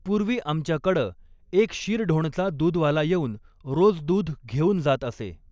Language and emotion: Marathi, neutral